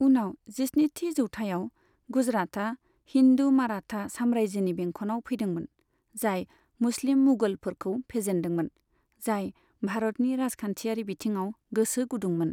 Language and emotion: Bodo, neutral